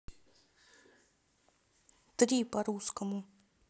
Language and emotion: Russian, neutral